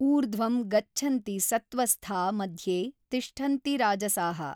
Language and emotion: Kannada, neutral